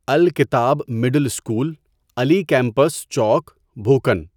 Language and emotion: Urdu, neutral